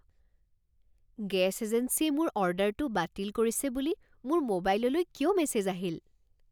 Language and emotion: Assamese, surprised